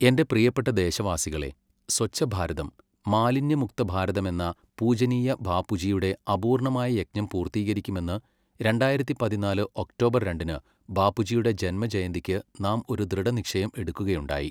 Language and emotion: Malayalam, neutral